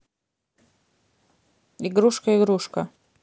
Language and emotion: Russian, neutral